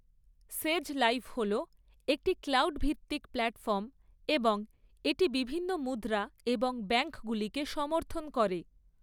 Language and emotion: Bengali, neutral